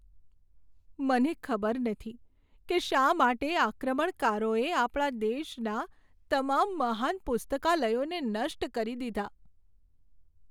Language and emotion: Gujarati, sad